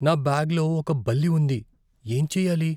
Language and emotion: Telugu, fearful